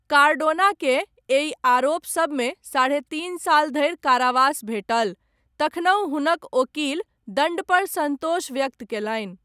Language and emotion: Maithili, neutral